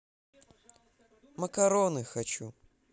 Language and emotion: Russian, neutral